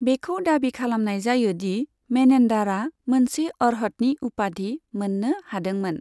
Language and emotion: Bodo, neutral